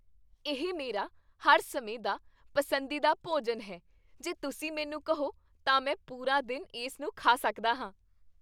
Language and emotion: Punjabi, happy